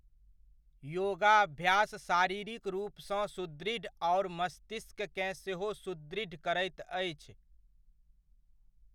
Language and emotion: Maithili, neutral